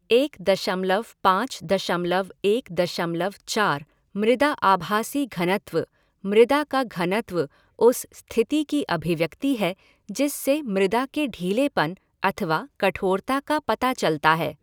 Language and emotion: Hindi, neutral